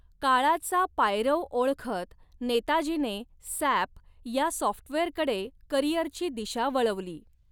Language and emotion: Marathi, neutral